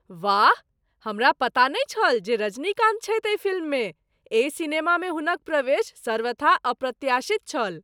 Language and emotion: Maithili, surprised